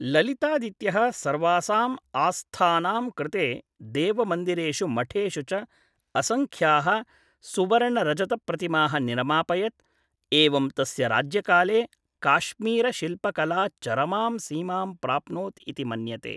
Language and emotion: Sanskrit, neutral